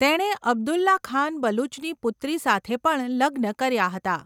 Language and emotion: Gujarati, neutral